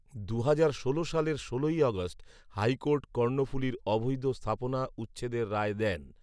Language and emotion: Bengali, neutral